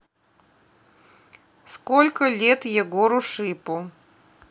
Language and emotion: Russian, neutral